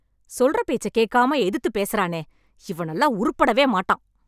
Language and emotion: Tamil, angry